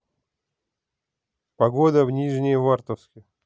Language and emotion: Russian, neutral